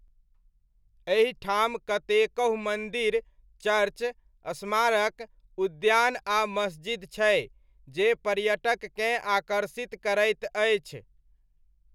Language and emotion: Maithili, neutral